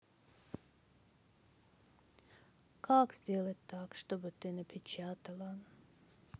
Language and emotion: Russian, sad